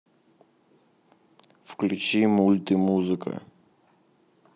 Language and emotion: Russian, neutral